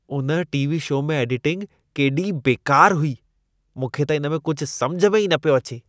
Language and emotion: Sindhi, disgusted